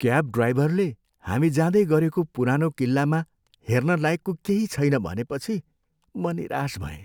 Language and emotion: Nepali, sad